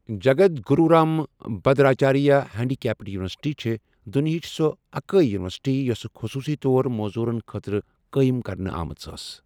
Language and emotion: Kashmiri, neutral